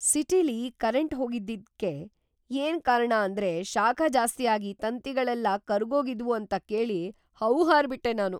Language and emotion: Kannada, surprised